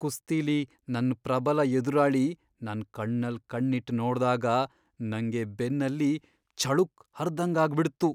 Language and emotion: Kannada, fearful